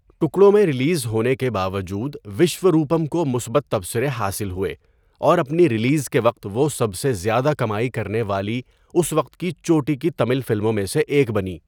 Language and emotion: Urdu, neutral